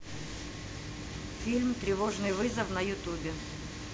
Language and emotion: Russian, neutral